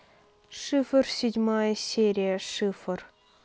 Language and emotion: Russian, neutral